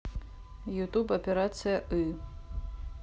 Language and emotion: Russian, neutral